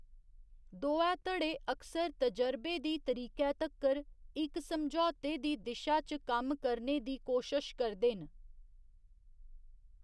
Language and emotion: Dogri, neutral